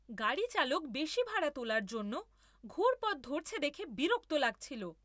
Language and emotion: Bengali, angry